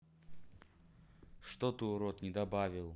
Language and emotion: Russian, neutral